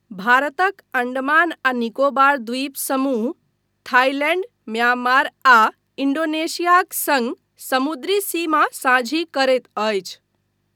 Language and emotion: Maithili, neutral